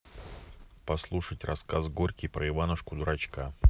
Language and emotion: Russian, neutral